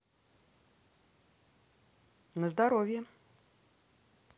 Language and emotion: Russian, positive